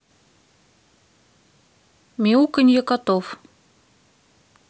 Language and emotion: Russian, neutral